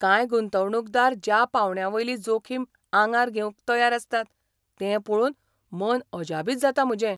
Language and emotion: Goan Konkani, surprised